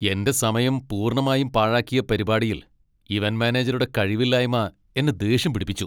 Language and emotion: Malayalam, angry